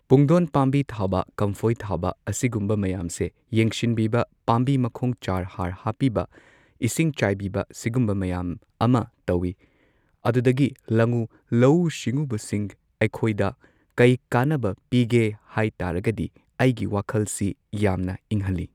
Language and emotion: Manipuri, neutral